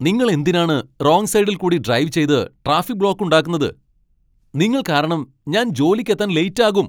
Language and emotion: Malayalam, angry